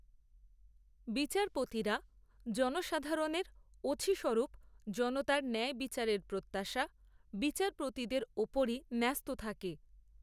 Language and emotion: Bengali, neutral